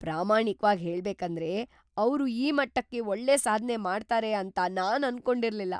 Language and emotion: Kannada, surprised